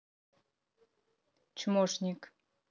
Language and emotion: Russian, neutral